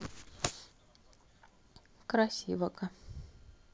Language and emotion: Russian, sad